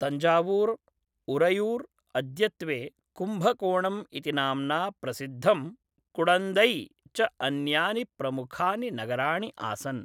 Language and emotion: Sanskrit, neutral